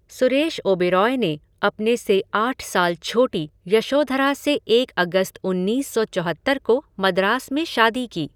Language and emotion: Hindi, neutral